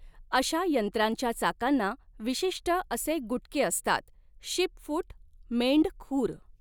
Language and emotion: Marathi, neutral